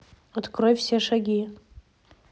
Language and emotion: Russian, neutral